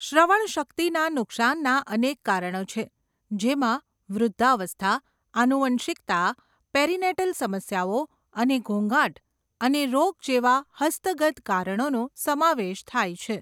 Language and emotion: Gujarati, neutral